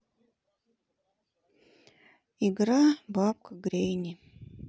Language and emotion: Russian, sad